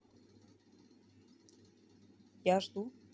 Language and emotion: Russian, neutral